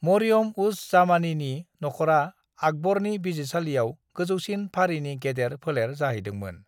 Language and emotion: Bodo, neutral